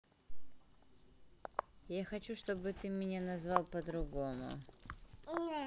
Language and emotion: Russian, neutral